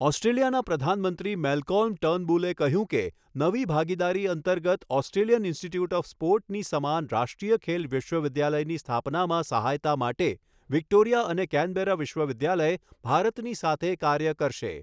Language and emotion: Gujarati, neutral